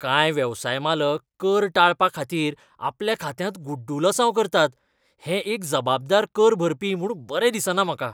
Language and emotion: Goan Konkani, disgusted